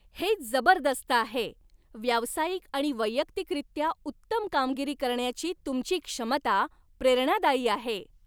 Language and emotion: Marathi, happy